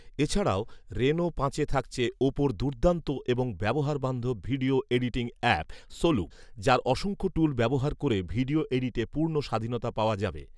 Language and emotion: Bengali, neutral